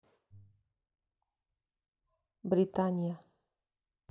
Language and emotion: Russian, neutral